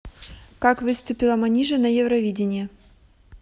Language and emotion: Russian, neutral